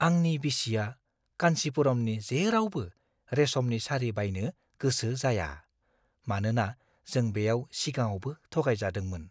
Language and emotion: Bodo, fearful